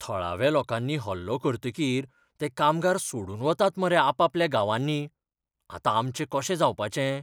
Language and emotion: Goan Konkani, fearful